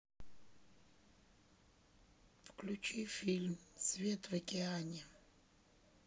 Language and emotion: Russian, neutral